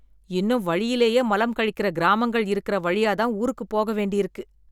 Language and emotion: Tamil, disgusted